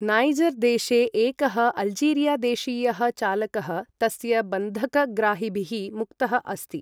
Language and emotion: Sanskrit, neutral